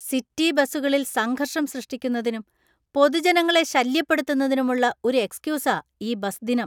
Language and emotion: Malayalam, disgusted